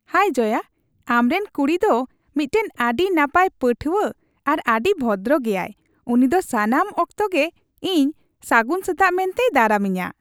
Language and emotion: Santali, happy